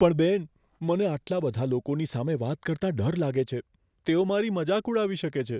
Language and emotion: Gujarati, fearful